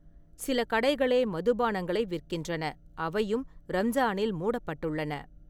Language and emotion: Tamil, neutral